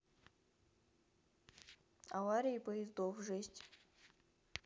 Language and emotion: Russian, neutral